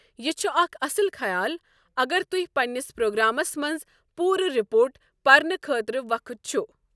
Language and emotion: Kashmiri, neutral